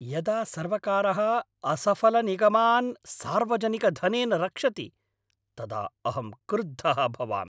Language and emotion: Sanskrit, angry